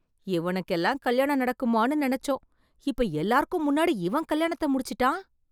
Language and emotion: Tamil, surprised